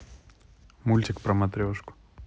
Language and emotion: Russian, neutral